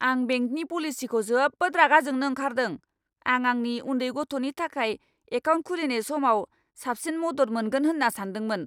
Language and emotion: Bodo, angry